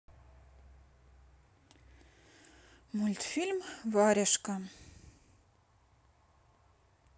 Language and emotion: Russian, sad